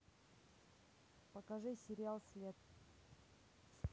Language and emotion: Russian, neutral